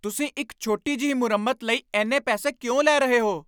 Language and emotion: Punjabi, angry